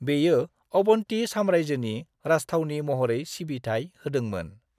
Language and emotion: Bodo, neutral